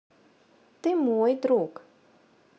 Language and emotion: Russian, neutral